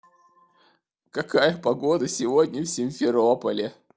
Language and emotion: Russian, sad